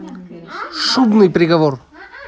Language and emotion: Russian, positive